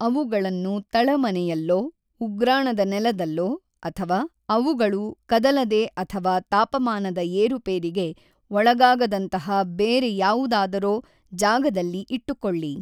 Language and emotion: Kannada, neutral